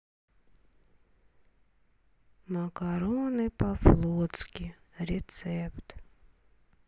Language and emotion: Russian, sad